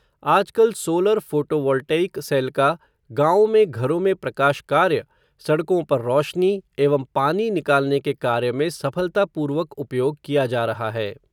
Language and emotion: Hindi, neutral